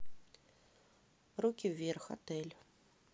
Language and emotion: Russian, neutral